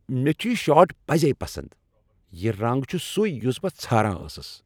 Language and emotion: Kashmiri, happy